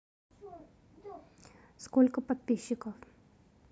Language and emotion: Russian, neutral